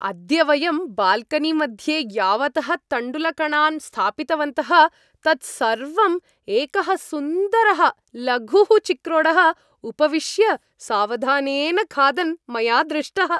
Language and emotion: Sanskrit, happy